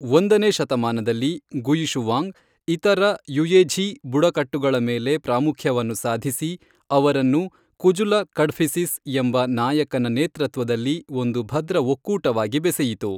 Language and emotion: Kannada, neutral